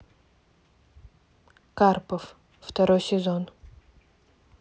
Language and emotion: Russian, neutral